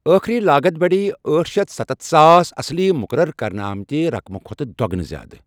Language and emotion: Kashmiri, neutral